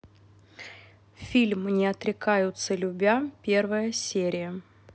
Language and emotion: Russian, neutral